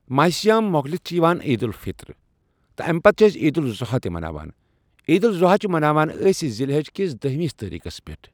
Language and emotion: Kashmiri, neutral